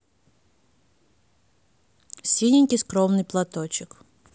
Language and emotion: Russian, neutral